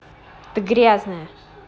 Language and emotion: Russian, angry